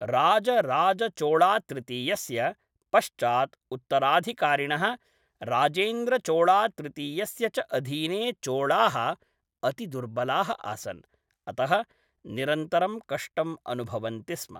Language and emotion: Sanskrit, neutral